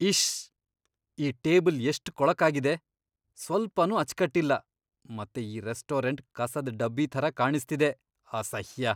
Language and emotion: Kannada, disgusted